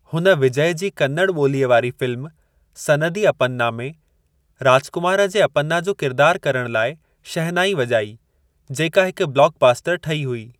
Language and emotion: Sindhi, neutral